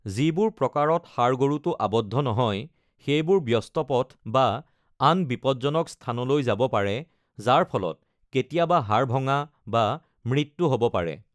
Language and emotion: Assamese, neutral